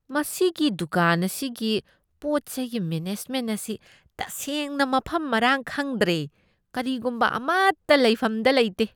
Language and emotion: Manipuri, disgusted